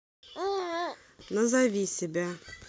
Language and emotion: Russian, neutral